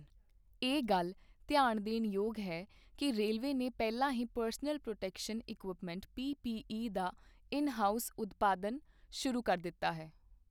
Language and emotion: Punjabi, neutral